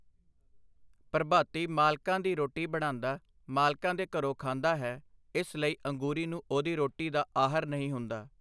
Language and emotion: Punjabi, neutral